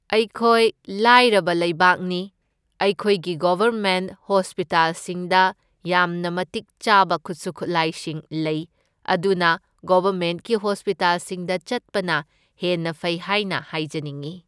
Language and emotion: Manipuri, neutral